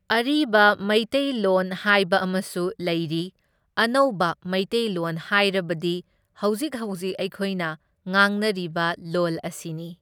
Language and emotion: Manipuri, neutral